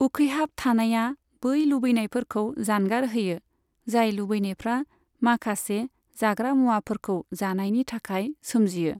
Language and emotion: Bodo, neutral